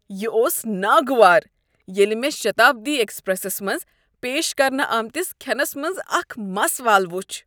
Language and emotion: Kashmiri, disgusted